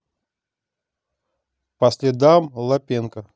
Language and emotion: Russian, neutral